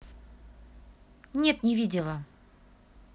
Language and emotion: Russian, neutral